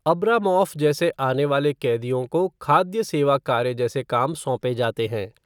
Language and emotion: Hindi, neutral